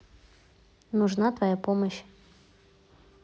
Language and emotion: Russian, neutral